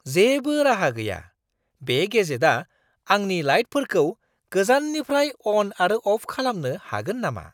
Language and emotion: Bodo, surprised